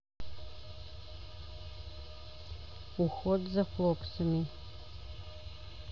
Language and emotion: Russian, neutral